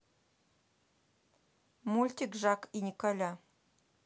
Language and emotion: Russian, neutral